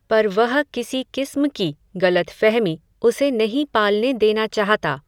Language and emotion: Hindi, neutral